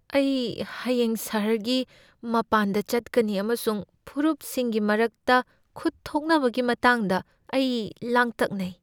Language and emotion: Manipuri, fearful